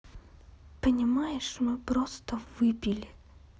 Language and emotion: Russian, neutral